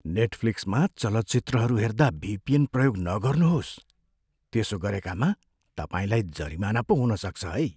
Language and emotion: Nepali, fearful